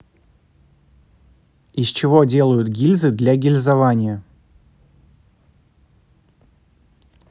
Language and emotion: Russian, neutral